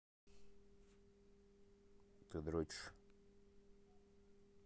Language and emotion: Russian, neutral